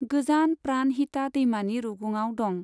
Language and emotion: Bodo, neutral